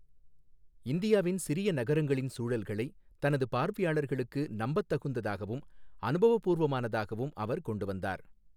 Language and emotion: Tamil, neutral